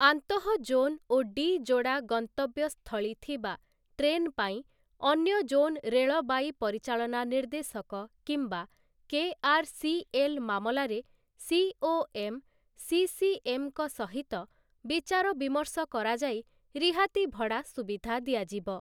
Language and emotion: Odia, neutral